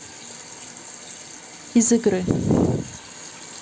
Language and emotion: Russian, neutral